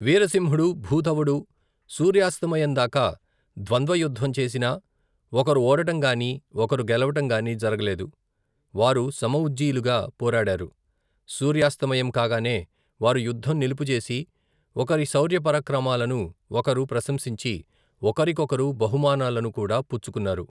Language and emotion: Telugu, neutral